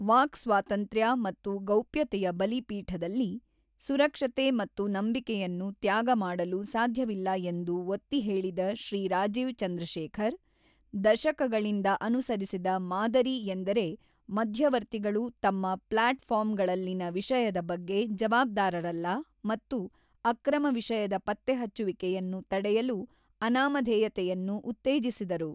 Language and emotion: Kannada, neutral